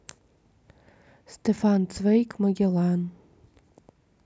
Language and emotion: Russian, neutral